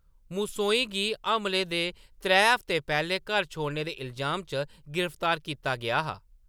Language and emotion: Dogri, neutral